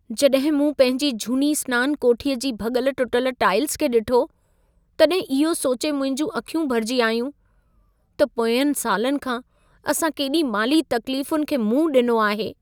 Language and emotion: Sindhi, sad